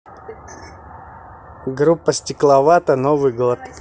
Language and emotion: Russian, positive